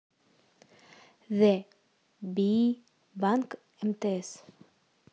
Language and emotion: Russian, neutral